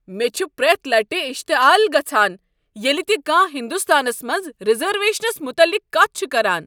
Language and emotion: Kashmiri, angry